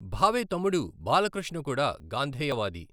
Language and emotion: Telugu, neutral